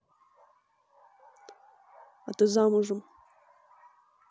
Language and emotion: Russian, neutral